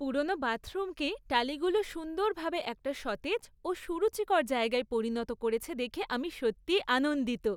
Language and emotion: Bengali, happy